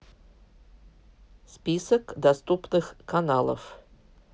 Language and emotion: Russian, neutral